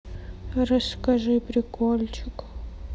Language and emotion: Russian, sad